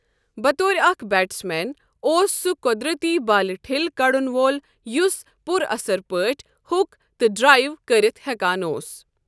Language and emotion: Kashmiri, neutral